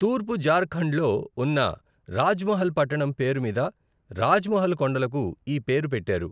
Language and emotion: Telugu, neutral